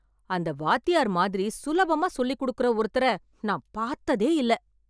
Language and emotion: Tamil, surprised